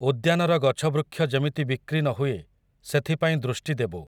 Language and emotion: Odia, neutral